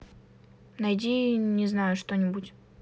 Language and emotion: Russian, neutral